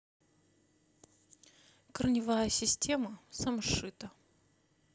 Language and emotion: Russian, neutral